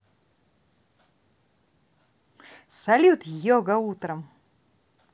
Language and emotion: Russian, positive